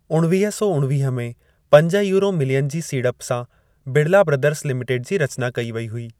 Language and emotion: Sindhi, neutral